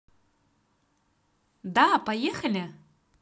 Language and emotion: Russian, positive